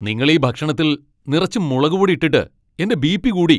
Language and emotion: Malayalam, angry